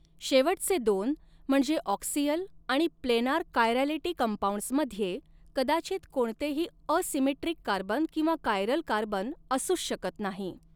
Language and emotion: Marathi, neutral